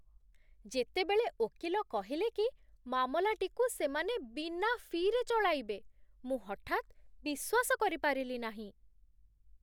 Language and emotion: Odia, surprised